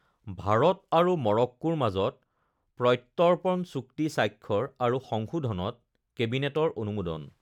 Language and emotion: Assamese, neutral